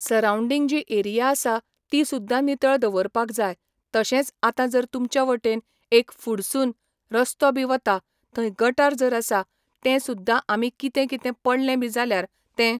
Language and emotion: Goan Konkani, neutral